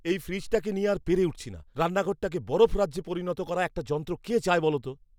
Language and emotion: Bengali, angry